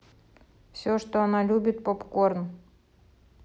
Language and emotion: Russian, neutral